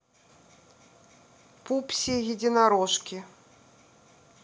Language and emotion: Russian, neutral